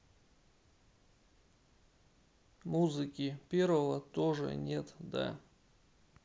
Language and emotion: Russian, sad